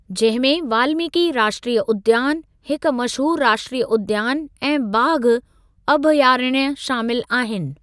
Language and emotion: Sindhi, neutral